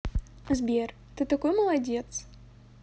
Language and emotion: Russian, positive